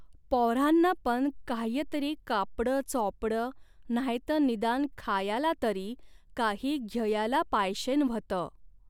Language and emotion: Marathi, neutral